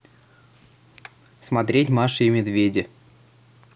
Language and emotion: Russian, neutral